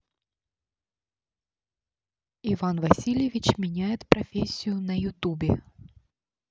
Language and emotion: Russian, neutral